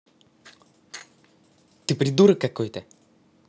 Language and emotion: Russian, angry